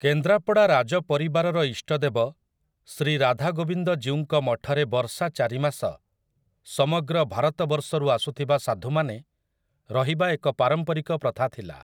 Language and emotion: Odia, neutral